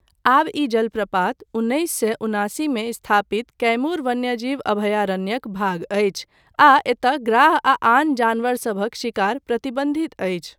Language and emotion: Maithili, neutral